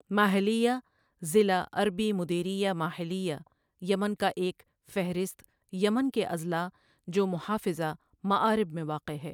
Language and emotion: Urdu, neutral